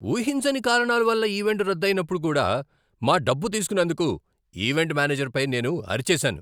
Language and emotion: Telugu, angry